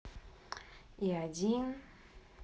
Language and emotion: Russian, neutral